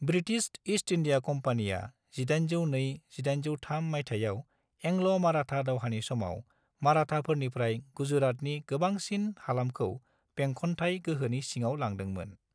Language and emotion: Bodo, neutral